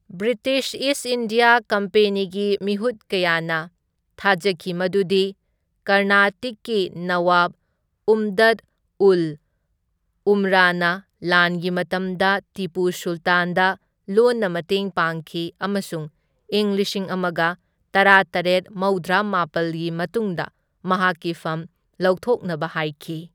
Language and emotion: Manipuri, neutral